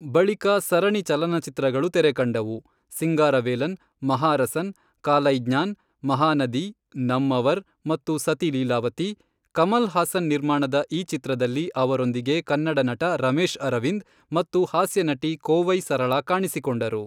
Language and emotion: Kannada, neutral